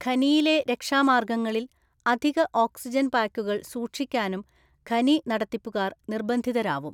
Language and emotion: Malayalam, neutral